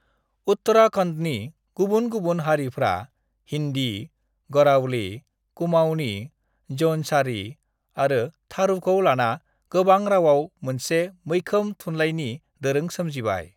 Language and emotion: Bodo, neutral